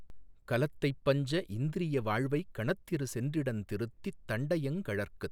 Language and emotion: Tamil, neutral